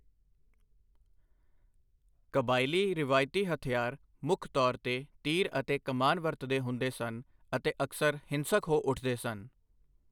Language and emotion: Punjabi, neutral